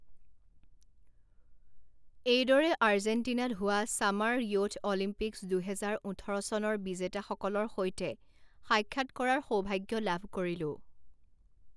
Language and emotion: Assamese, neutral